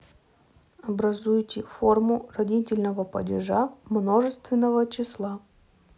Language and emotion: Russian, neutral